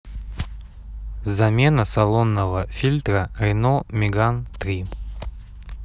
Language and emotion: Russian, neutral